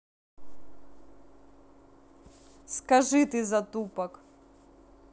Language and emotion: Russian, neutral